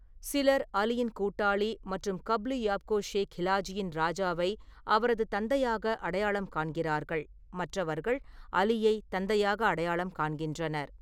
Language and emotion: Tamil, neutral